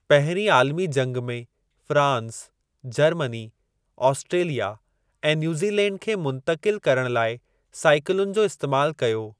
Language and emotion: Sindhi, neutral